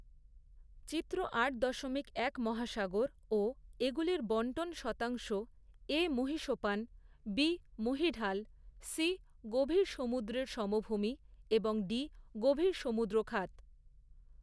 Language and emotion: Bengali, neutral